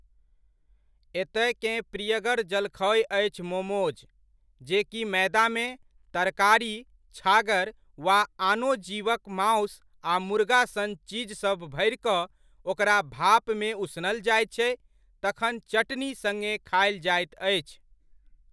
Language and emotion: Maithili, neutral